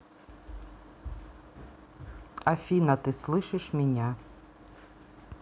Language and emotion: Russian, neutral